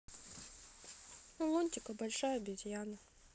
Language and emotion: Russian, sad